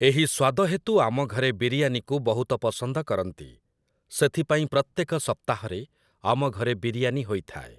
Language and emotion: Odia, neutral